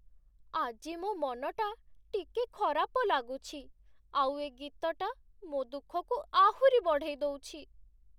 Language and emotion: Odia, sad